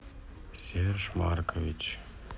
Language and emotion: Russian, sad